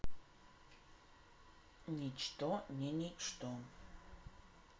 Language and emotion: Russian, neutral